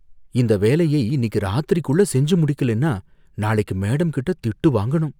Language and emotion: Tamil, fearful